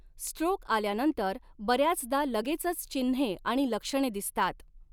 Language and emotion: Marathi, neutral